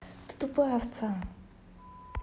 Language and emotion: Russian, angry